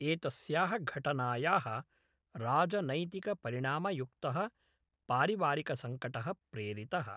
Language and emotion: Sanskrit, neutral